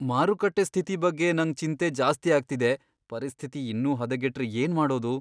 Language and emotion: Kannada, fearful